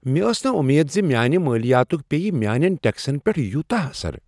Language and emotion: Kashmiri, surprised